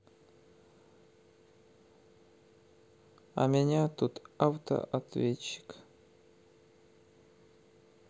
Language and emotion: Russian, sad